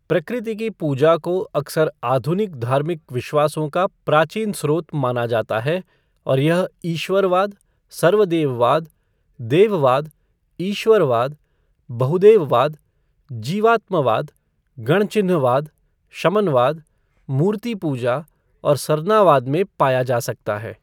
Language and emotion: Hindi, neutral